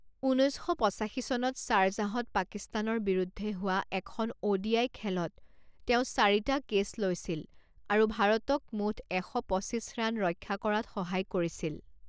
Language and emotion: Assamese, neutral